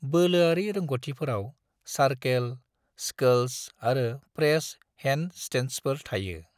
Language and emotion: Bodo, neutral